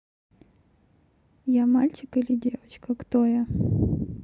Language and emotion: Russian, neutral